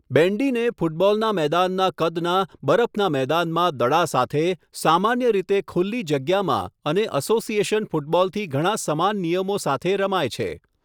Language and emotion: Gujarati, neutral